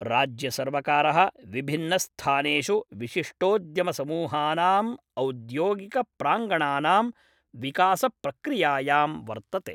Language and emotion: Sanskrit, neutral